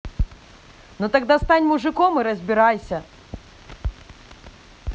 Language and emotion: Russian, angry